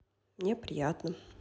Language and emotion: Russian, neutral